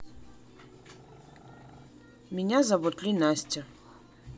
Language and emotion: Russian, neutral